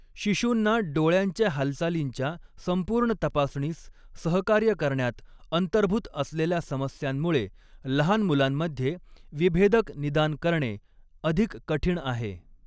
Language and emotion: Marathi, neutral